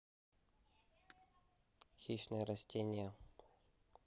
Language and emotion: Russian, neutral